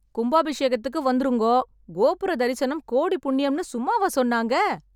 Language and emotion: Tamil, happy